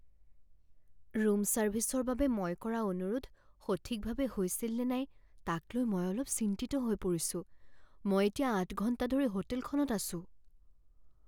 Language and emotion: Assamese, fearful